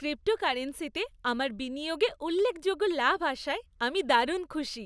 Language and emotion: Bengali, happy